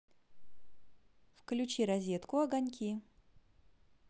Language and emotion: Russian, positive